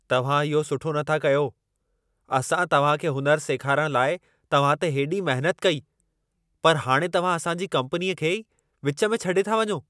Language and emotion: Sindhi, angry